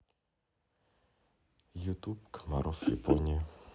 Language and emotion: Russian, neutral